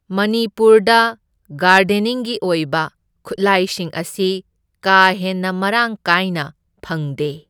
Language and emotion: Manipuri, neutral